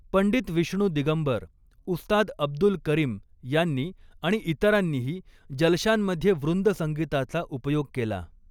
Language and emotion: Marathi, neutral